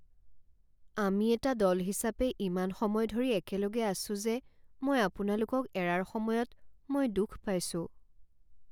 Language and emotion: Assamese, sad